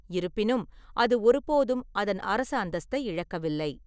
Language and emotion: Tamil, neutral